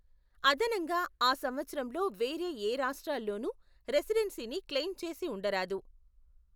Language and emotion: Telugu, neutral